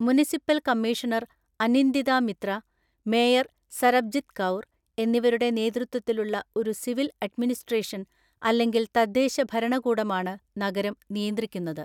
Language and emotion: Malayalam, neutral